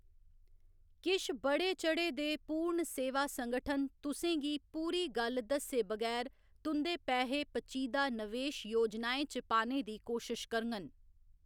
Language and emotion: Dogri, neutral